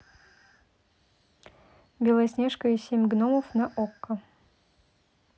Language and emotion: Russian, neutral